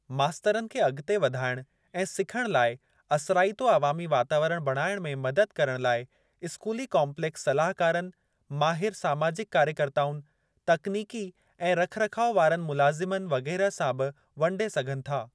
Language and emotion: Sindhi, neutral